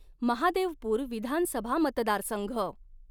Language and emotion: Marathi, neutral